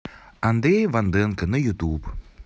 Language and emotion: Russian, positive